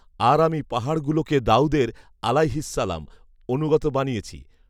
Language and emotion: Bengali, neutral